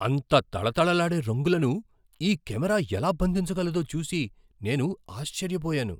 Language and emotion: Telugu, surprised